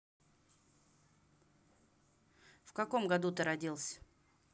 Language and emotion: Russian, neutral